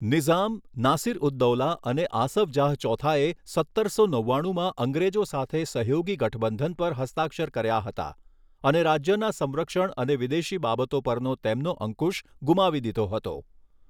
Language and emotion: Gujarati, neutral